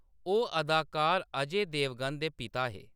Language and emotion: Dogri, neutral